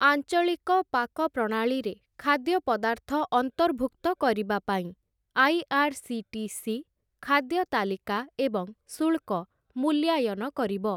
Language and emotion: Odia, neutral